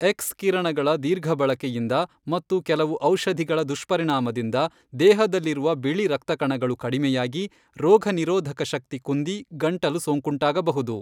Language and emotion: Kannada, neutral